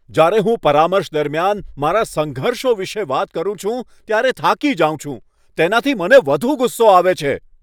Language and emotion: Gujarati, angry